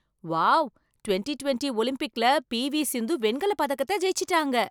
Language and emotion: Tamil, surprised